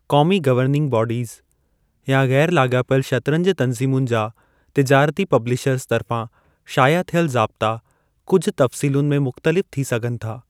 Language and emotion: Sindhi, neutral